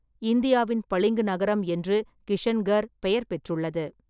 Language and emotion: Tamil, neutral